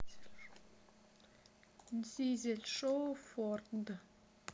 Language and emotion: Russian, neutral